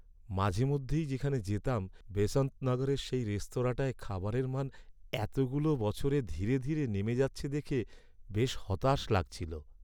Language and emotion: Bengali, sad